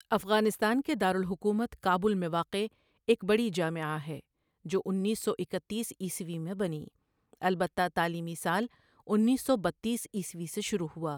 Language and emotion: Urdu, neutral